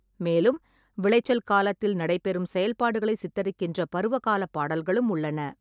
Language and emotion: Tamil, neutral